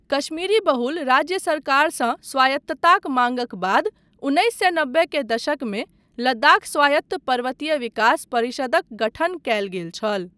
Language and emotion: Maithili, neutral